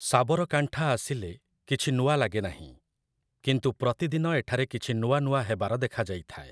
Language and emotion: Odia, neutral